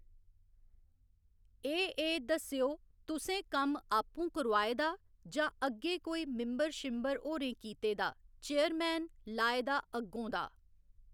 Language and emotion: Dogri, neutral